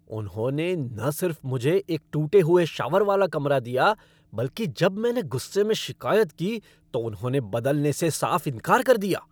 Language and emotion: Hindi, angry